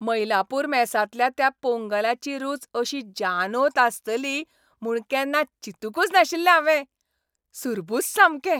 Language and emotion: Goan Konkani, happy